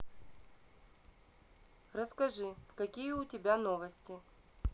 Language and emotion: Russian, neutral